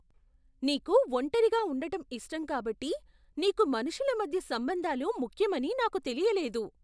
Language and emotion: Telugu, surprised